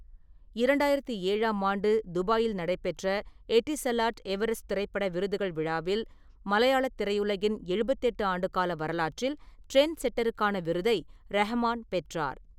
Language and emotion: Tamil, neutral